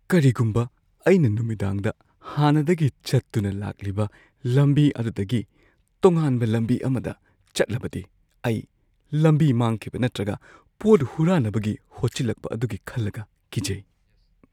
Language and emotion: Manipuri, fearful